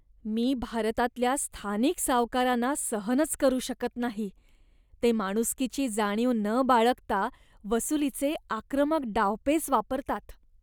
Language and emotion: Marathi, disgusted